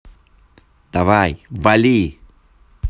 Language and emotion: Russian, angry